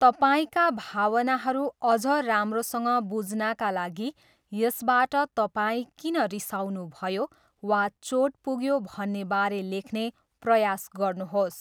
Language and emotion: Nepali, neutral